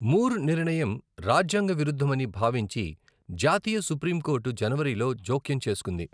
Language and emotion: Telugu, neutral